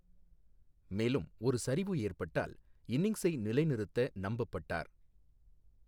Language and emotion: Tamil, neutral